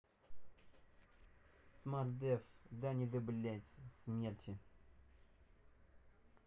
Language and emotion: Russian, angry